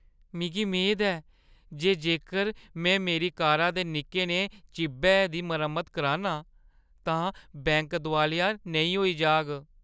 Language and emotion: Dogri, fearful